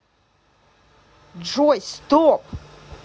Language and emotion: Russian, angry